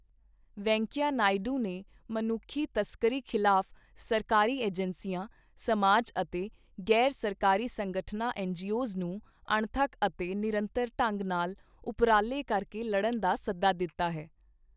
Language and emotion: Punjabi, neutral